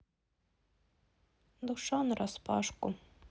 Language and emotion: Russian, sad